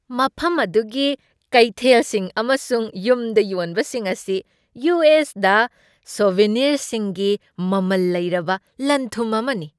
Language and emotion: Manipuri, happy